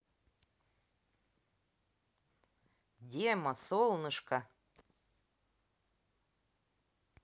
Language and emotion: Russian, positive